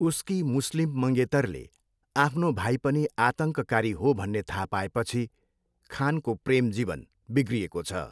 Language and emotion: Nepali, neutral